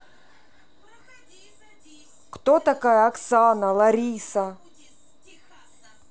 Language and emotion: Russian, neutral